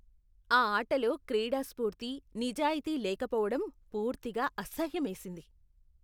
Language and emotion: Telugu, disgusted